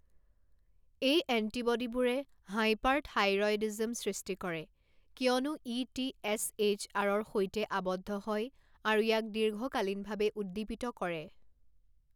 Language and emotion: Assamese, neutral